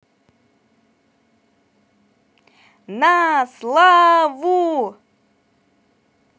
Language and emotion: Russian, positive